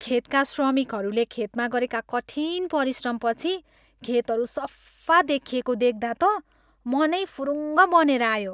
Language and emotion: Nepali, happy